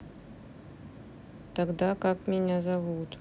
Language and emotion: Russian, neutral